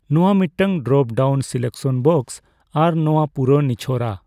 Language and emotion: Santali, neutral